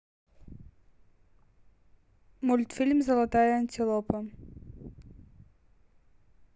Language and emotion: Russian, neutral